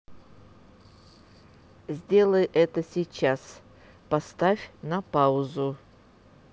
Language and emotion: Russian, neutral